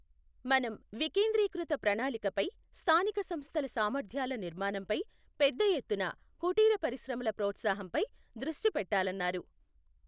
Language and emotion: Telugu, neutral